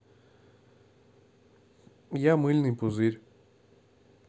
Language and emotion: Russian, neutral